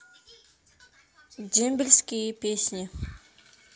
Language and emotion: Russian, neutral